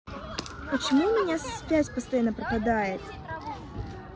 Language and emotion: Russian, neutral